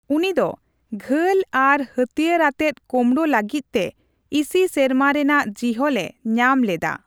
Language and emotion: Santali, neutral